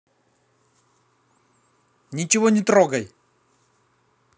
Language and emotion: Russian, angry